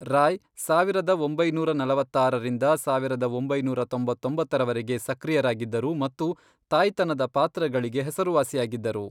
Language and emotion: Kannada, neutral